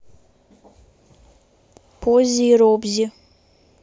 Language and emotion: Russian, neutral